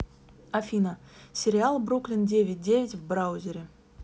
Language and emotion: Russian, neutral